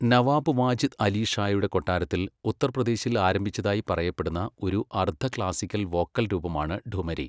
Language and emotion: Malayalam, neutral